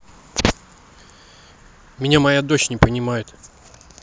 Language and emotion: Russian, angry